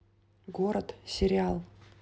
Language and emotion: Russian, neutral